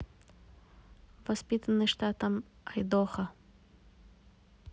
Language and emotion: Russian, neutral